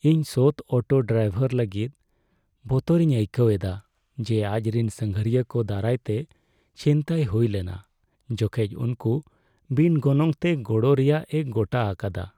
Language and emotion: Santali, sad